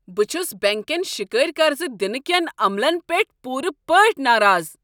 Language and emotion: Kashmiri, angry